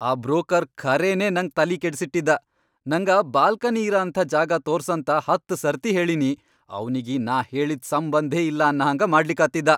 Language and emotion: Kannada, angry